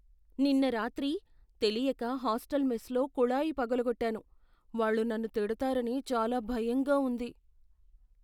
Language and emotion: Telugu, fearful